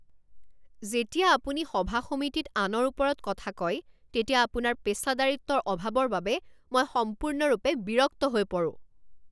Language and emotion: Assamese, angry